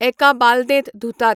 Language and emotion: Goan Konkani, neutral